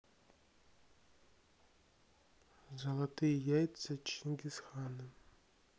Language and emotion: Russian, neutral